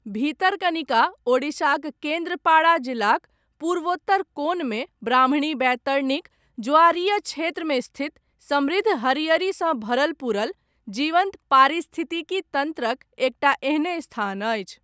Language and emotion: Maithili, neutral